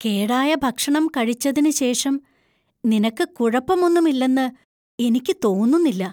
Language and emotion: Malayalam, fearful